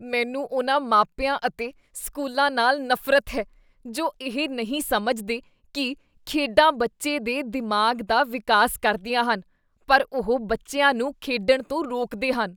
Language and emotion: Punjabi, disgusted